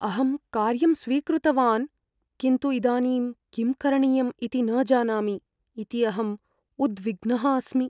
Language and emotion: Sanskrit, fearful